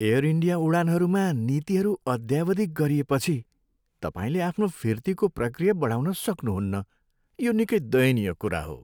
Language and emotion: Nepali, sad